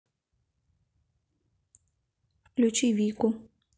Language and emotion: Russian, neutral